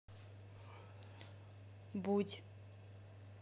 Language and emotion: Russian, neutral